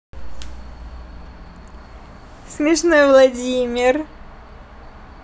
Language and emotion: Russian, positive